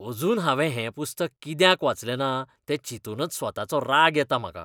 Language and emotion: Goan Konkani, disgusted